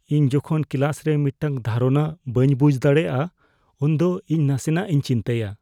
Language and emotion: Santali, fearful